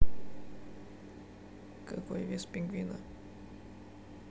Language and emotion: Russian, sad